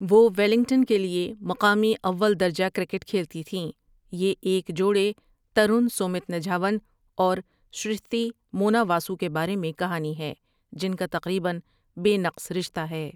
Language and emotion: Urdu, neutral